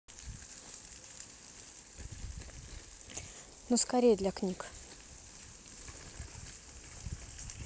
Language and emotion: Russian, neutral